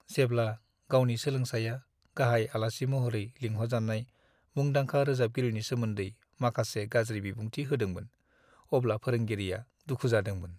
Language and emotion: Bodo, sad